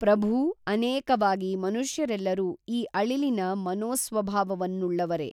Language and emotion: Kannada, neutral